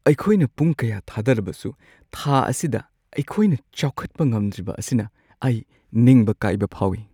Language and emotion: Manipuri, sad